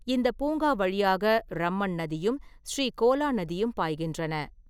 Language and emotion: Tamil, neutral